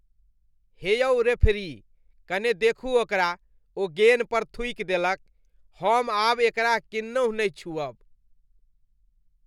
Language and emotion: Maithili, disgusted